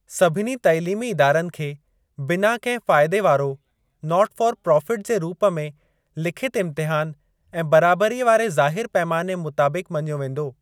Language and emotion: Sindhi, neutral